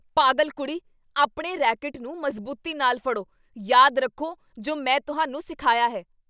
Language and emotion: Punjabi, angry